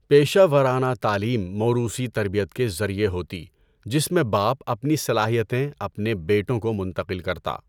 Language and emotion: Urdu, neutral